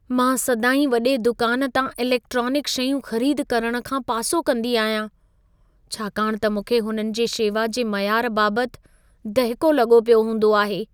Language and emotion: Sindhi, fearful